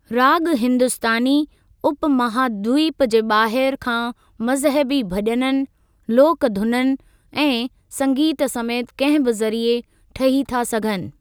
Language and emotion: Sindhi, neutral